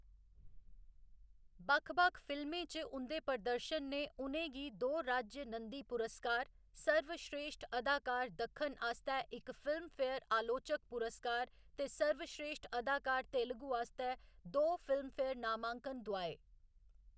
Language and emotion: Dogri, neutral